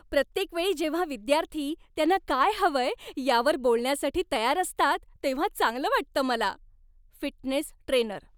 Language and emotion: Marathi, happy